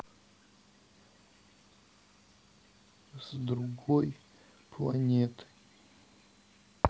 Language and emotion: Russian, sad